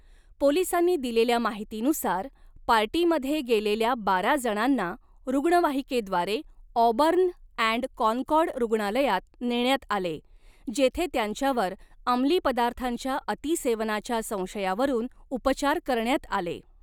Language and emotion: Marathi, neutral